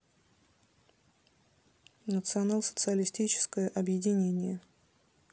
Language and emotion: Russian, neutral